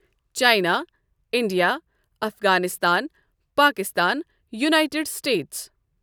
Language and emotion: Kashmiri, neutral